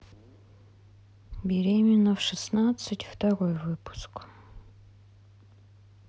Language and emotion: Russian, sad